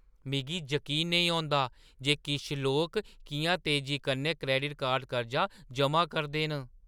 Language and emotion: Dogri, surprised